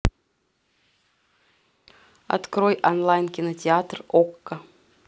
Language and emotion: Russian, neutral